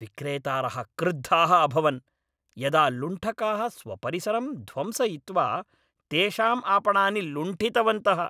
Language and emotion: Sanskrit, angry